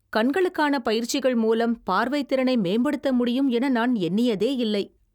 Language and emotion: Tamil, surprised